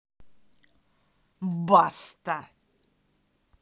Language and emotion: Russian, angry